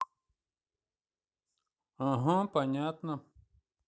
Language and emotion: Russian, neutral